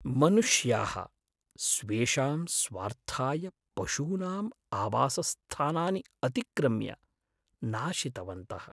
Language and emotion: Sanskrit, sad